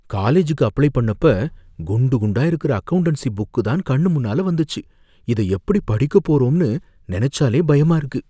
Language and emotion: Tamil, fearful